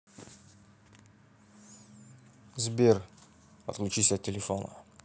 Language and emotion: Russian, neutral